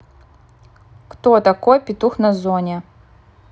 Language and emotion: Russian, neutral